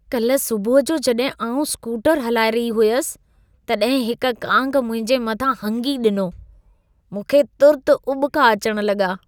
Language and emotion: Sindhi, disgusted